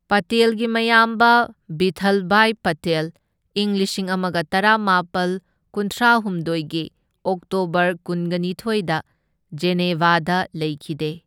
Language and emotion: Manipuri, neutral